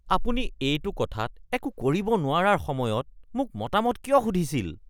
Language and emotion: Assamese, disgusted